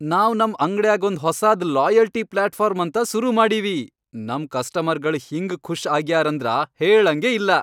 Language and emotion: Kannada, happy